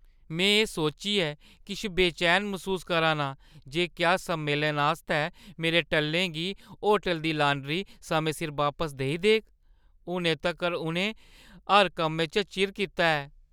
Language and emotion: Dogri, fearful